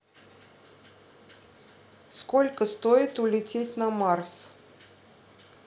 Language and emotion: Russian, neutral